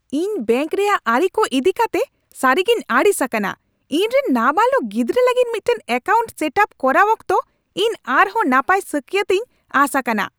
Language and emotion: Santali, angry